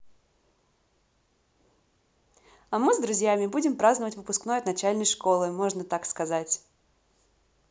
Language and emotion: Russian, positive